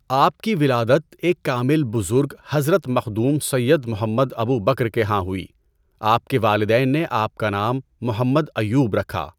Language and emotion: Urdu, neutral